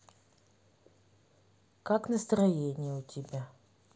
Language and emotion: Russian, neutral